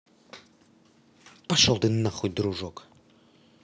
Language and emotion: Russian, angry